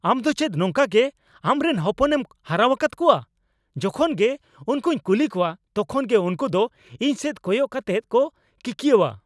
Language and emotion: Santali, angry